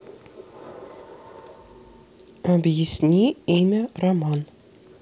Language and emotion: Russian, neutral